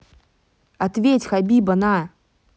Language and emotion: Russian, angry